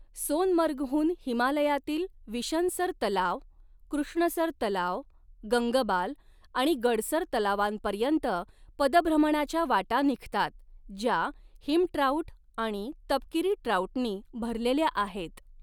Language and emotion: Marathi, neutral